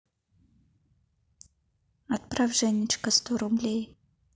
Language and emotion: Russian, neutral